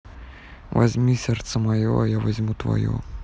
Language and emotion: Russian, neutral